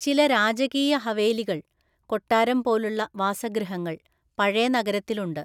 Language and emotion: Malayalam, neutral